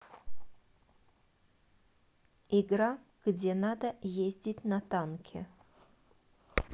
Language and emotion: Russian, neutral